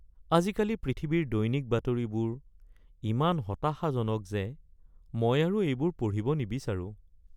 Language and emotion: Assamese, sad